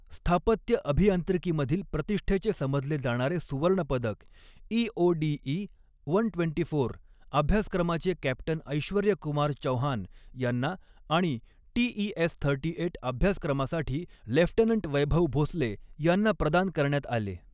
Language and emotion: Marathi, neutral